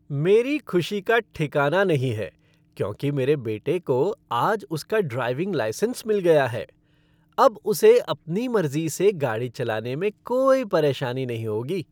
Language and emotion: Hindi, happy